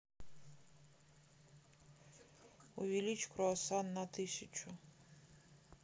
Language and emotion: Russian, sad